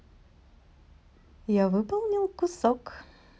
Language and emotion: Russian, positive